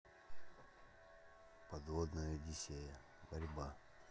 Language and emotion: Russian, neutral